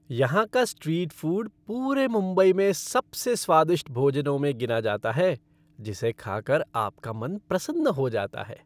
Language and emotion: Hindi, happy